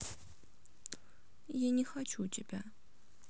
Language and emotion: Russian, sad